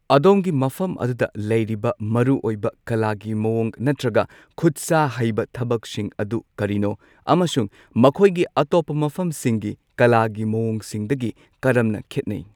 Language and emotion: Manipuri, neutral